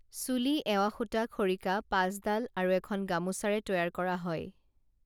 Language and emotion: Assamese, neutral